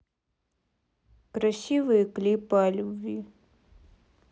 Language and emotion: Russian, sad